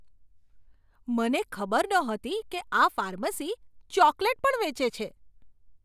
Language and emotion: Gujarati, surprised